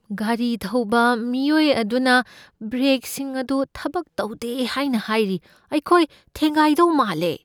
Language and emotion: Manipuri, fearful